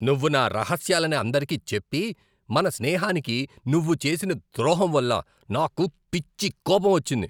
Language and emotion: Telugu, angry